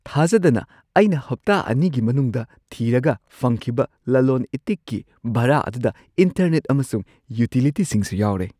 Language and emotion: Manipuri, surprised